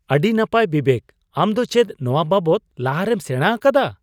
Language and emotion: Santali, surprised